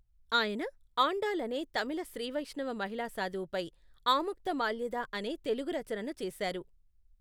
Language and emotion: Telugu, neutral